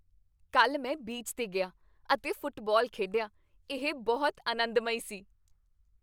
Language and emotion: Punjabi, happy